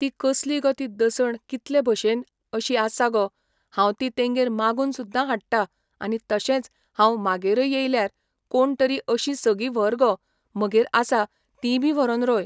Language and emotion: Goan Konkani, neutral